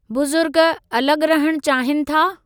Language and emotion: Sindhi, neutral